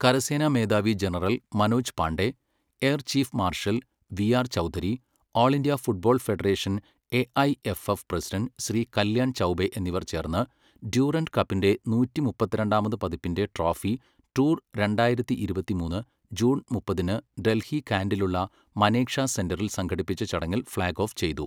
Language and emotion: Malayalam, neutral